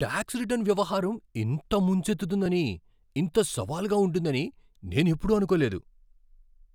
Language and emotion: Telugu, surprised